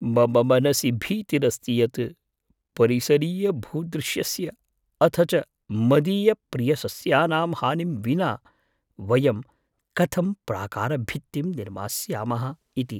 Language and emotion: Sanskrit, fearful